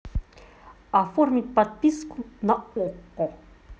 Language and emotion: Russian, neutral